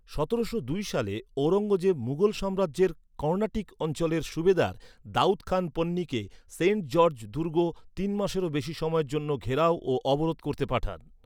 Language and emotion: Bengali, neutral